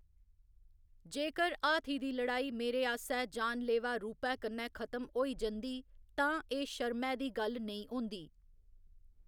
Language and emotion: Dogri, neutral